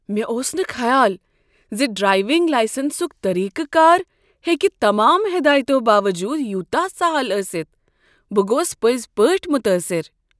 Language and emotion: Kashmiri, surprised